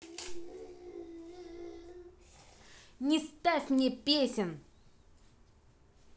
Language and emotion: Russian, angry